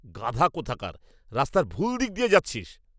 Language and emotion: Bengali, angry